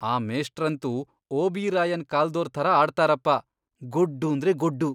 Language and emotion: Kannada, disgusted